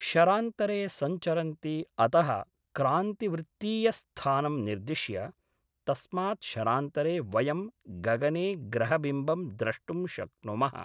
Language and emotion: Sanskrit, neutral